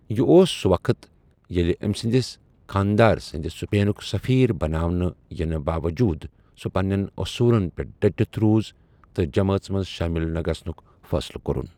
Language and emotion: Kashmiri, neutral